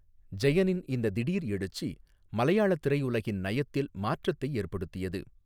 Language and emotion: Tamil, neutral